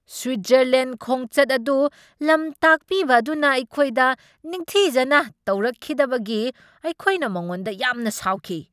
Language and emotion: Manipuri, angry